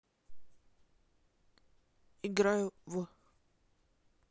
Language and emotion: Russian, neutral